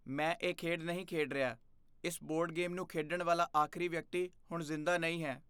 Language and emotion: Punjabi, fearful